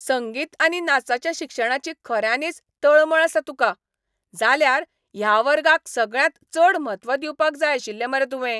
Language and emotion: Goan Konkani, angry